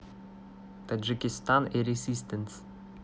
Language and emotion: Russian, neutral